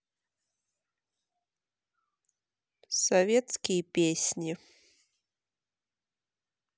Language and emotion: Russian, neutral